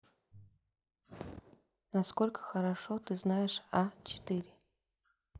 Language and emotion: Russian, neutral